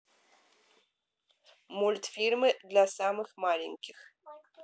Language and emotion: Russian, neutral